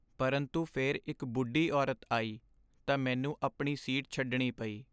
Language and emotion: Punjabi, sad